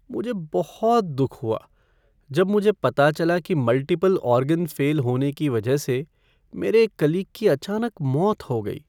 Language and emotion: Hindi, sad